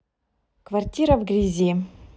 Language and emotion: Russian, neutral